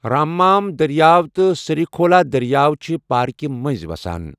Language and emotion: Kashmiri, neutral